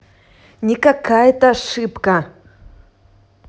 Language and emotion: Russian, angry